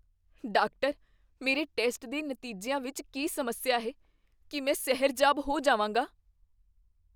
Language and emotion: Punjabi, fearful